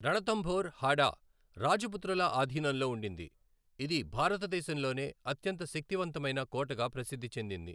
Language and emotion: Telugu, neutral